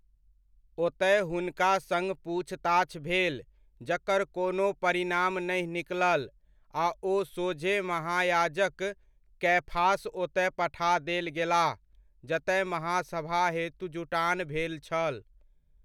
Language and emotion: Maithili, neutral